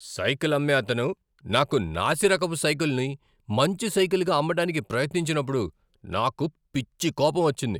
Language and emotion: Telugu, angry